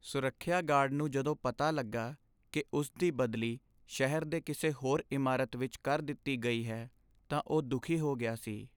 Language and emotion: Punjabi, sad